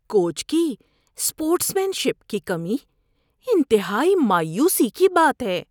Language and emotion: Urdu, disgusted